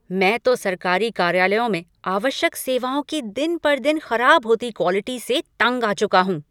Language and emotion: Hindi, angry